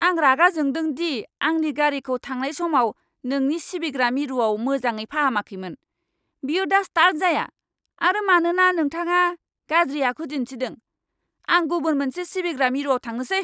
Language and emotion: Bodo, angry